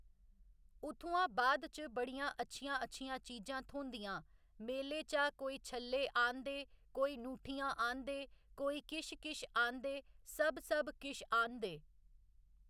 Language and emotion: Dogri, neutral